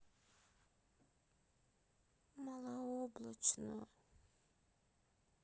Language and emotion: Russian, sad